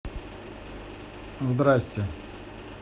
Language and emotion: Russian, neutral